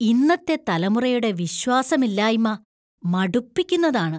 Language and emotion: Malayalam, disgusted